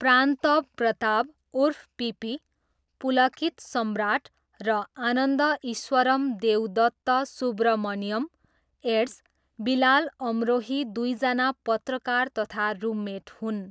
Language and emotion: Nepali, neutral